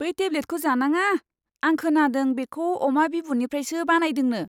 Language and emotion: Bodo, disgusted